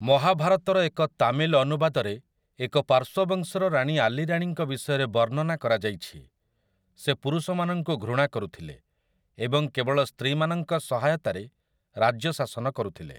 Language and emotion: Odia, neutral